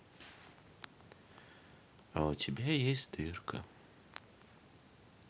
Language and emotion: Russian, neutral